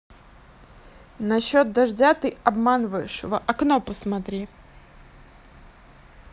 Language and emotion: Russian, angry